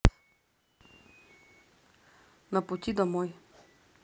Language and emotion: Russian, neutral